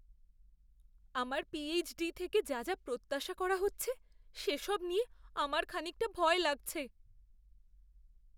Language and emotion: Bengali, fearful